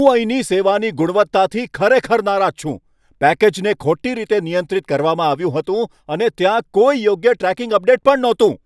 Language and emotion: Gujarati, angry